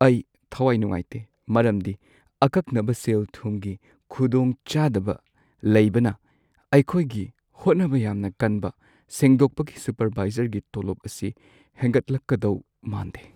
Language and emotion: Manipuri, sad